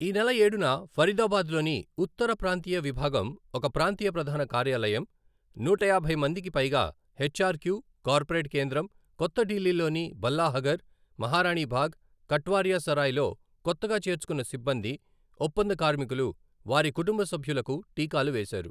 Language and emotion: Telugu, neutral